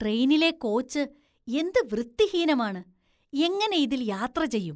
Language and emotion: Malayalam, disgusted